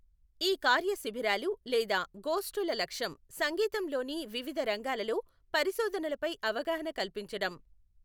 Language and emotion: Telugu, neutral